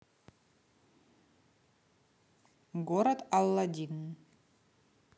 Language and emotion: Russian, neutral